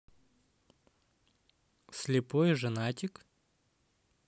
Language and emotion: Russian, positive